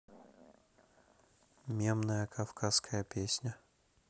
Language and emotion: Russian, neutral